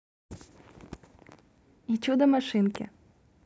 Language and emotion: Russian, neutral